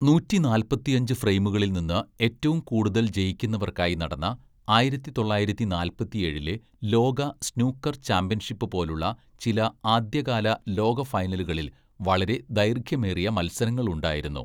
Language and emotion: Malayalam, neutral